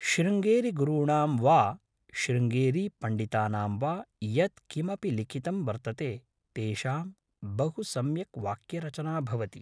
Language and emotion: Sanskrit, neutral